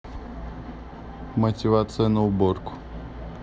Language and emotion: Russian, neutral